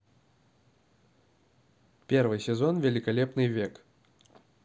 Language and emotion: Russian, neutral